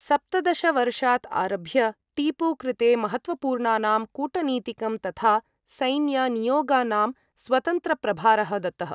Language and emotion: Sanskrit, neutral